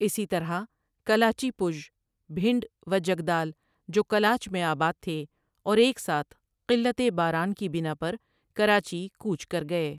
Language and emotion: Urdu, neutral